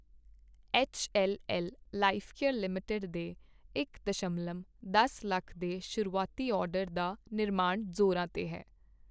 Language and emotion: Punjabi, neutral